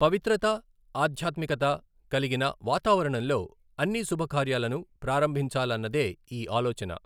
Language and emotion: Telugu, neutral